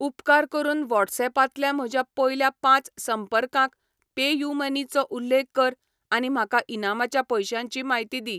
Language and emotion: Goan Konkani, neutral